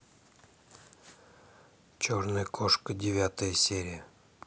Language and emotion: Russian, neutral